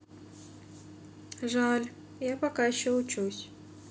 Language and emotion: Russian, sad